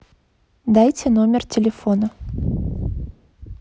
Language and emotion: Russian, neutral